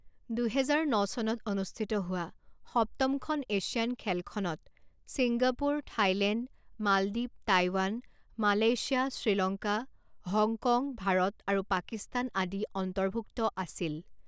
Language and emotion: Assamese, neutral